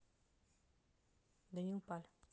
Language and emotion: Russian, neutral